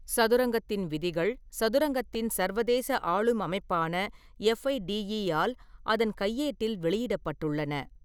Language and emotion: Tamil, neutral